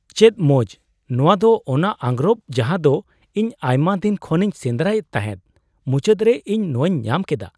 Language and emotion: Santali, surprised